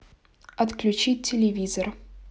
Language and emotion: Russian, neutral